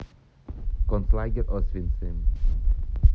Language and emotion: Russian, neutral